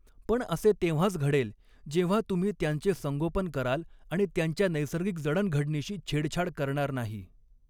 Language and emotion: Marathi, neutral